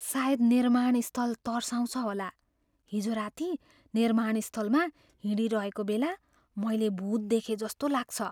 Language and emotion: Nepali, fearful